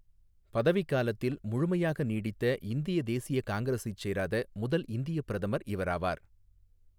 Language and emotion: Tamil, neutral